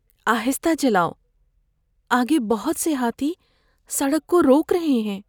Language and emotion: Urdu, fearful